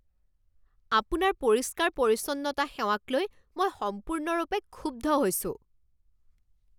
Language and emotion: Assamese, angry